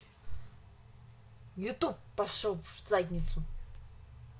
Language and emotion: Russian, angry